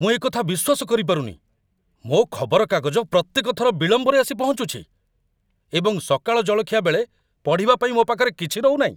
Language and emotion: Odia, angry